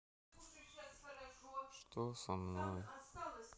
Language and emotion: Russian, sad